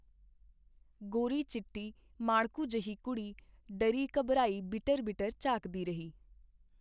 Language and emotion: Punjabi, neutral